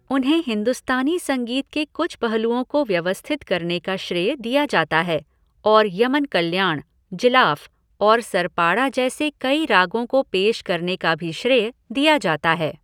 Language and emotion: Hindi, neutral